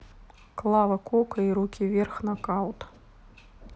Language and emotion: Russian, neutral